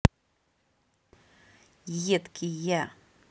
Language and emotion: Russian, angry